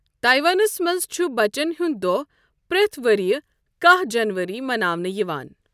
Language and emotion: Kashmiri, neutral